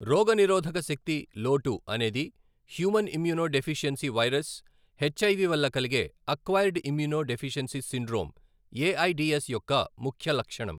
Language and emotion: Telugu, neutral